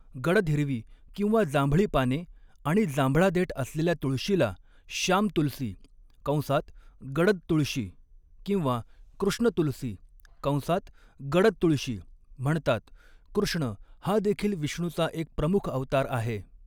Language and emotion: Marathi, neutral